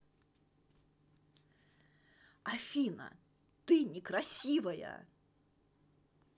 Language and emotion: Russian, angry